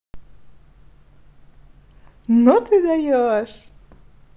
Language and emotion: Russian, positive